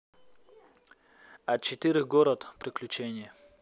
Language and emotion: Russian, neutral